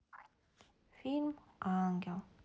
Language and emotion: Russian, sad